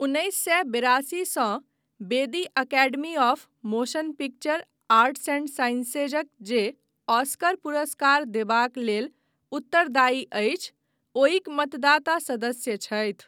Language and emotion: Maithili, neutral